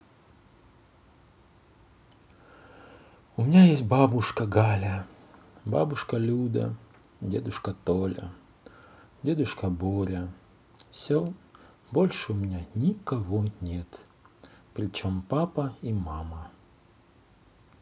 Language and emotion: Russian, sad